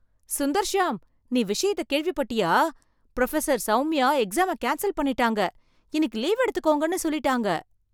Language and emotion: Tamil, surprised